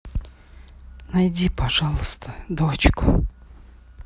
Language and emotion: Russian, sad